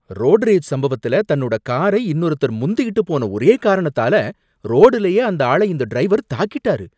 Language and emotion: Tamil, angry